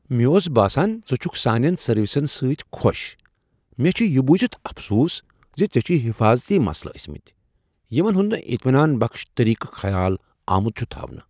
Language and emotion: Kashmiri, surprised